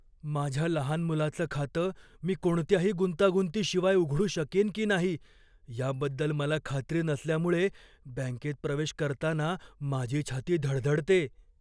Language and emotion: Marathi, fearful